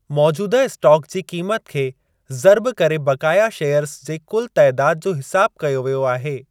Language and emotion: Sindhi, neutral